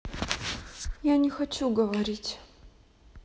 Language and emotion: Russian, sad